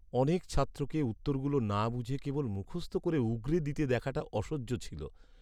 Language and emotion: Bengali, sad